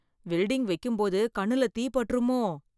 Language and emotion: Tamil, fearful